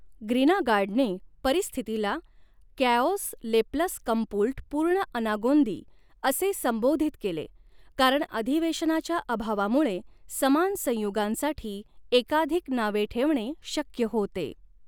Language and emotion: Marathi, neutral